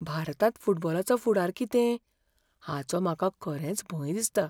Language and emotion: Goan Konkani, fearful